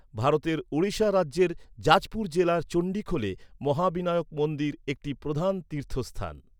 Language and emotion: Bengali, neutral